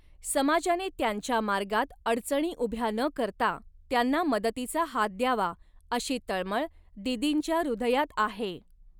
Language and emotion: Marathi, neutral